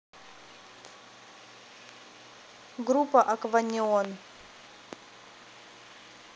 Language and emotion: Russian, neutral